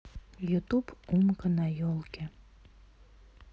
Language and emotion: Russian, sad